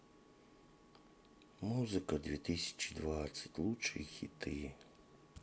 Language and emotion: Russian, sad